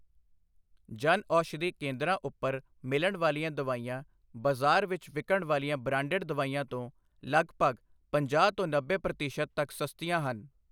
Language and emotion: Punjabi, neutral